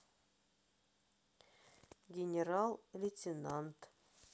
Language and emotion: Russian, neutral